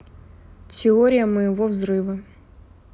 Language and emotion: Russian, neutral